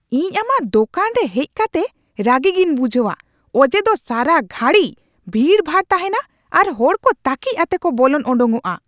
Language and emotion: Santali, angry